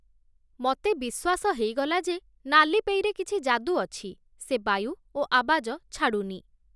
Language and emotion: Odia, neutral